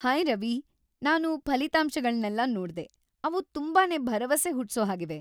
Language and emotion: Kannada, happy